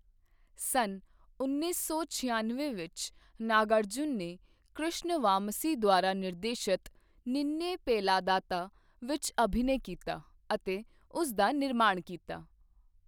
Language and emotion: Punjabi, neutral